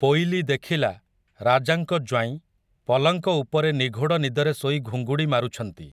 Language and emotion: Odia, neutral